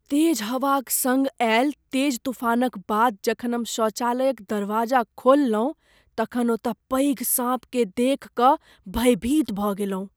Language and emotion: Maithili, fearful